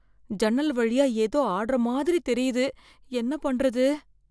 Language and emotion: Tamil, fearful